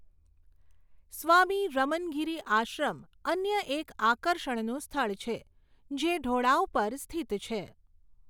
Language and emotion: Gujarati, neutral